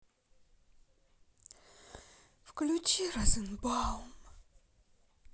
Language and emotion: Russian, sad